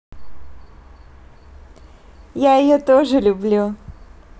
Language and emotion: Russian, positive